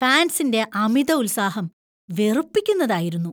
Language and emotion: Malayalam, disgusted